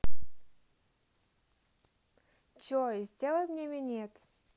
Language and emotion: Russian, neutral